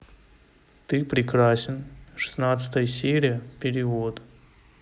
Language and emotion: Russian, neutral